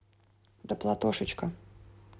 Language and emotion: Russian, neutral